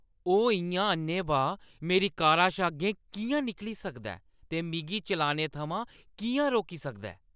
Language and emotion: Dogri, angry